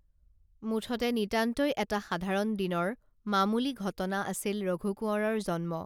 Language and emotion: Assamese, neutral